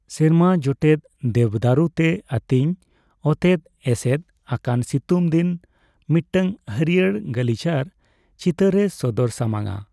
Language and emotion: Santali, neutral